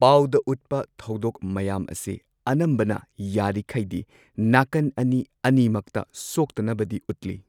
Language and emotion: Manipuri, neutral